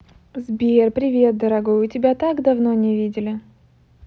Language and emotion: Russian, positive